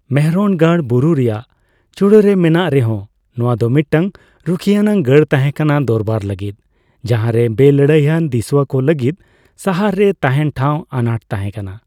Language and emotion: Santali, neutral